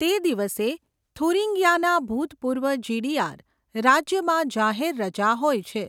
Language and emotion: Gujarati, neutral